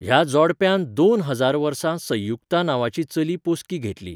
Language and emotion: Goan Konkani, neutral